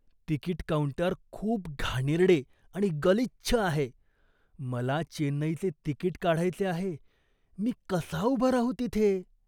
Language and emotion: Marathi, disgusted